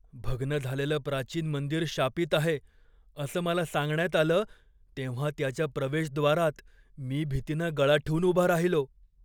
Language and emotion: Marathi, fearful